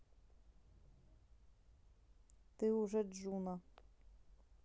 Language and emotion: Russian, neutral